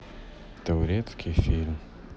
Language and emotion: Russian, sad